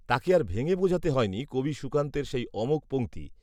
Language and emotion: Bengali, neutral